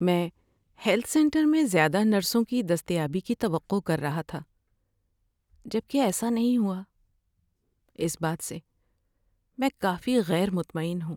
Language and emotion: Urdu, sad